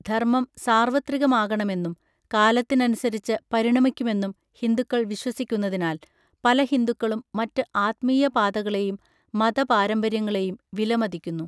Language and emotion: Malayalam, neutral